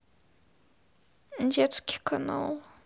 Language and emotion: Russian, sad